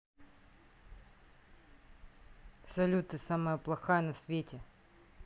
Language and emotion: Russian, neutral